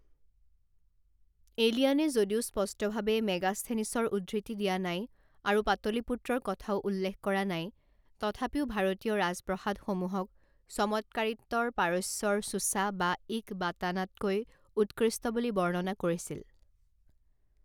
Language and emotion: Assamese, neutral